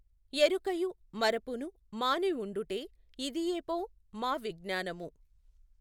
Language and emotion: Telugu, neutral